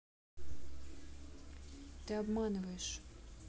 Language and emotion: Russian, sad